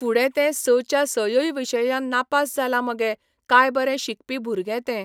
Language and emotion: Goan Konkani, neutral